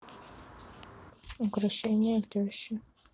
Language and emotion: Russian, neutral